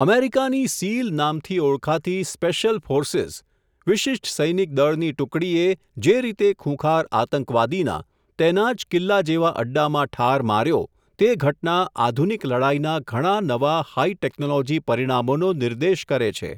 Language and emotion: Gujarati, neutral